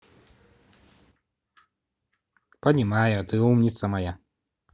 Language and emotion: Russian, positive